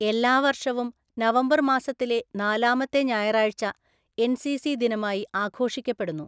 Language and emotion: Malayalam, neutral